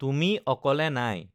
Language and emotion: Assamese, neutral